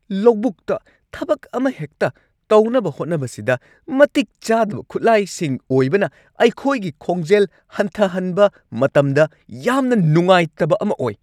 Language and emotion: Manipuri, angry